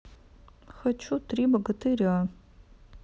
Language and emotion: Russian, sad